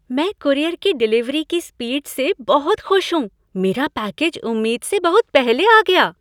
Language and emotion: Hindi, happy